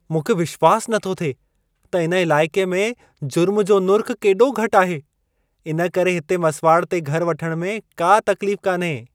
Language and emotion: Sindhi, surprised